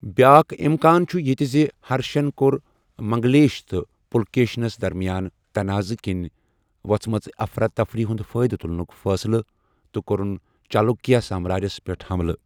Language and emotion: Kashmiri, neutral